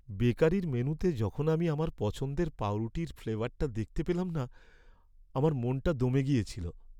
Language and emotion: Bengali, sad